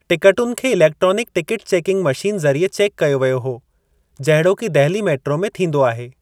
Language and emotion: Sindhi, neutral